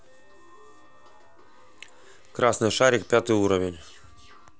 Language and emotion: Russian, neutral